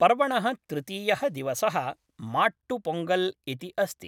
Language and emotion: Sanskrit, neutral